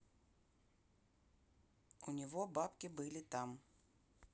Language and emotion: Russian, neutral